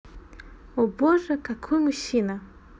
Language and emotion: Russian, positive